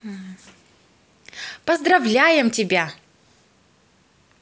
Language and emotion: Russian, positive